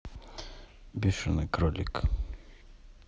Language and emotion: Russian, neutral